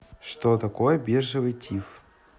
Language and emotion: Russian, neutral